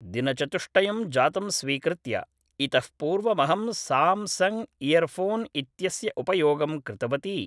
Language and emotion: Sanskrit, neutral